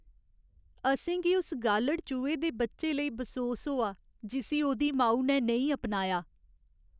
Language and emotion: Dogri, sad